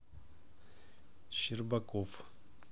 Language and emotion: Russian, neutral